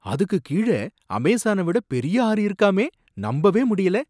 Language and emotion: Tamil, surprised